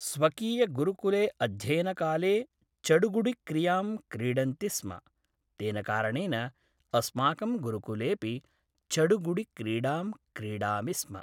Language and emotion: Sanskrit, neutral